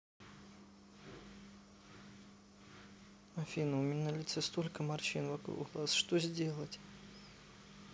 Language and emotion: Russian, sad